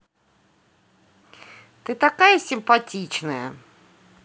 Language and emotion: Russian, positive